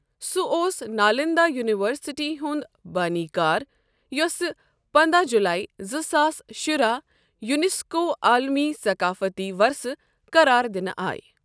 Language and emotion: Kashmiri, neutral